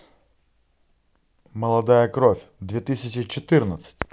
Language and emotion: Russian, positive